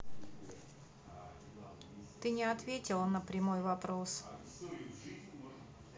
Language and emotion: Russian, neutral